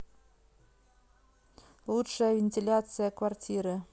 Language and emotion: Russian, neutral